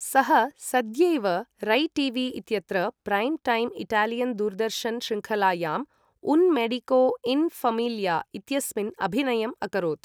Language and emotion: Sanskrit, neutral